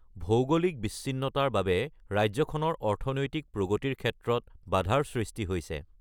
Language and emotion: Assamese, neutral